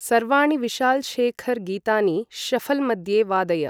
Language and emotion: Sanskrit, neutral